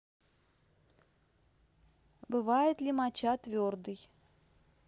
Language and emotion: Russian, neutral